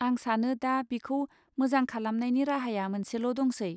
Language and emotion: Bodo, neutral